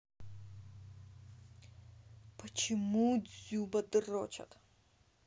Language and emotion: Russian, angry